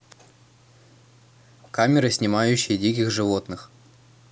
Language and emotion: Russian, neutral